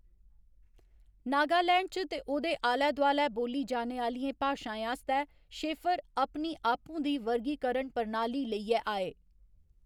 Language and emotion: Dogri, neutral